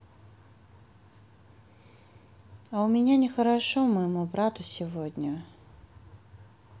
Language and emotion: Russian, sad